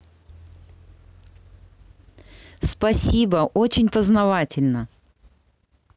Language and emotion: Russian, positive